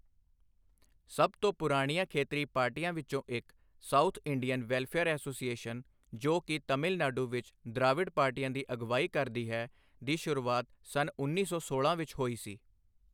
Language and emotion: Punjabi, neutral